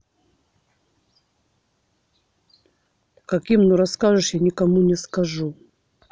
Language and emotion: Russian, angry